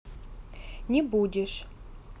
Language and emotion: Russian, neutral